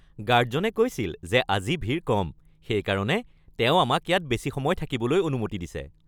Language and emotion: Assamese, happy